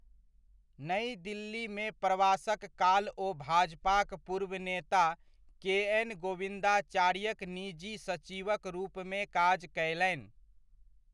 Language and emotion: Maithili, neutral